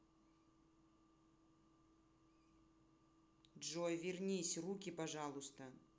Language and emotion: Russian, angry